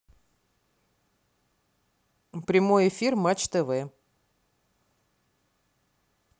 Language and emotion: Russian, neutral